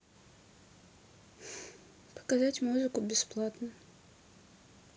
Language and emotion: Russian, neutral